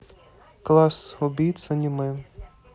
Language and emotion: Russian, neutral